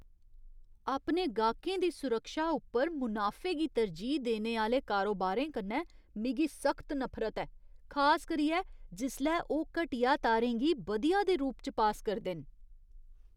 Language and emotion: Dogri, disgusted